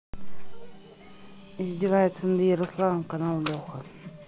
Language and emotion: Russian, neutral